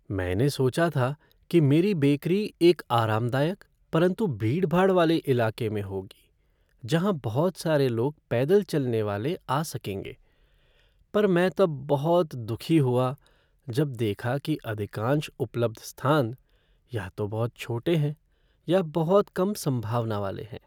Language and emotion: Hindi, sad